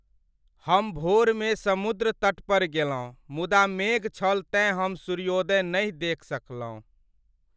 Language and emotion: Maithili, sad